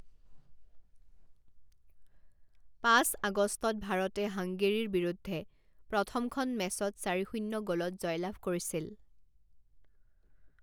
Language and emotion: Assamese, neutral